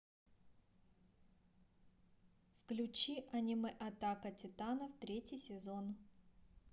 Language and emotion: Russian, neutral